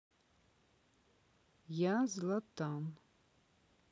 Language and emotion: Russian, neutral